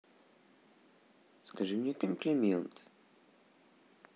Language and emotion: Russian, neutral